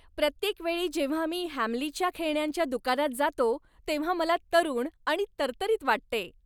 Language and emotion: Marathi, happy